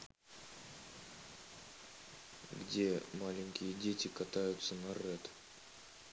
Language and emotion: Russian, neutral